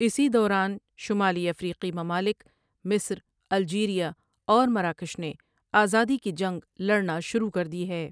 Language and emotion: Urdu, neutral